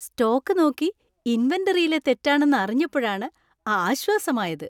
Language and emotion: Malayalam, happy